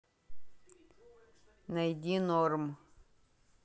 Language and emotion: Russian, neutral